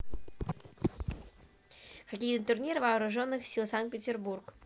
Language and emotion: Russian, neutral